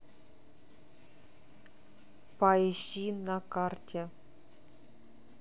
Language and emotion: Russian, neutral